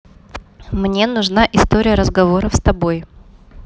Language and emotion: Russian, neutral